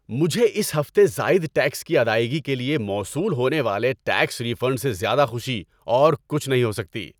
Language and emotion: Urdu, happy